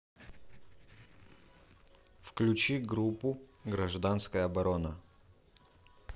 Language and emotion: Russian, neutral